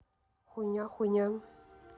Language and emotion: Russian, neutral